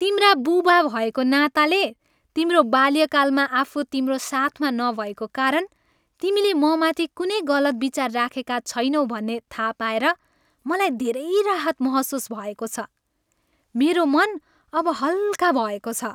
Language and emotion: Nepali, happy